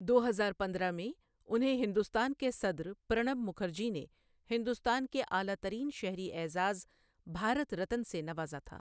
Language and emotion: Urdu, neutral